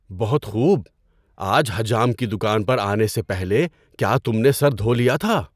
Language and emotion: Urdu, surprised